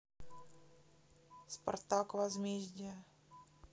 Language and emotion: Russian, neutral